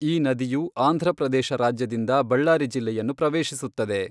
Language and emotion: Kannada, neutral